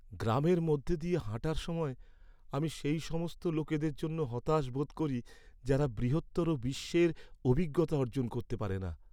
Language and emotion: Bengali, sad